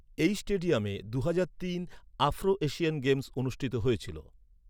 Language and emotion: Bengali, neutral